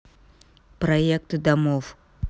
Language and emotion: Russian, neutral